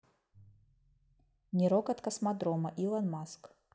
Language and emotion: Russian, neutral